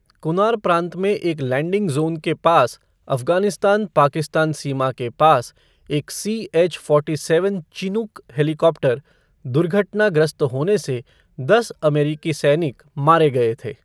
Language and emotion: Hindi, neutral